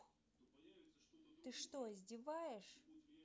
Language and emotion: Russian, angry